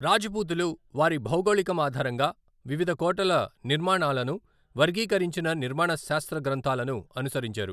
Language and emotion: Telugu, neutral